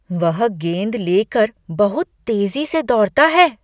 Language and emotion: Hindi, surprised